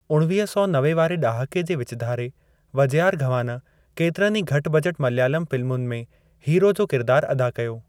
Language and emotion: Sindhi, neutral